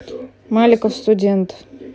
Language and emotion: Russian, neutral